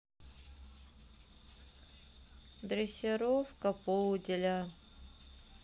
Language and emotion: Russian, sad